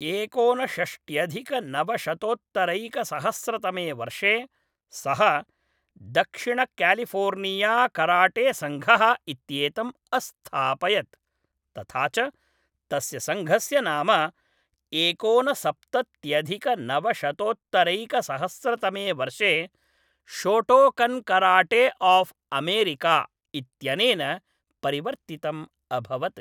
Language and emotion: Sanskrit, neutral